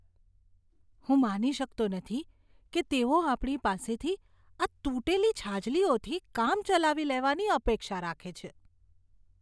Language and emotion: Gujarati, disgusted